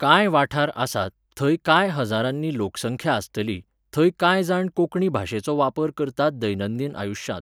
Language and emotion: Goan Konkani, neutral